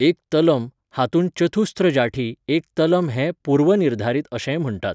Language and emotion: Goan Konkani, neutral